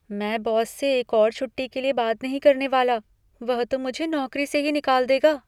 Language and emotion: Hindi, fearful